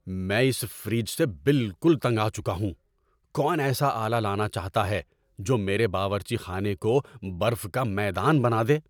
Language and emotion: Urdu, angry